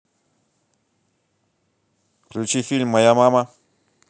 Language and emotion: Russian, positive